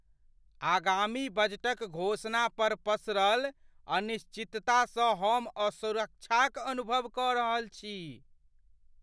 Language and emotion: Maithili, fearful